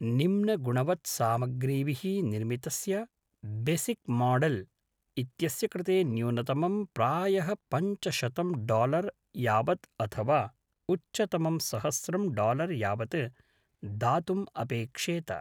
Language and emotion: Sanskrit, neutral